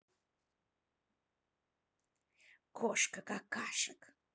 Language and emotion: Russian, angry